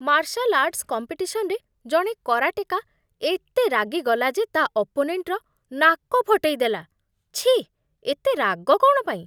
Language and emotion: Odia, disgusted